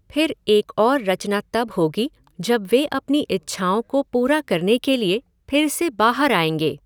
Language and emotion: Hindi, neutral